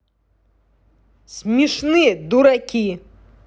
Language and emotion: Russian, angry